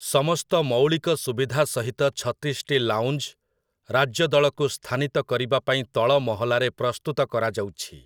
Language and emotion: Odia, neutral